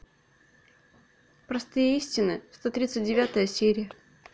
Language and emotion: Russian, neutral